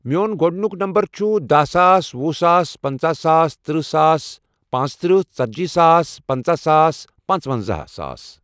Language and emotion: Kashmiri, neutral